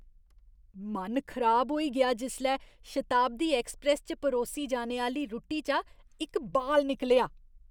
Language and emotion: Dogri, disgusted